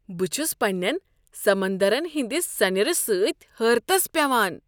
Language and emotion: Kashmiri, surprised